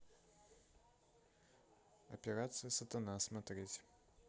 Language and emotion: Russian, neutral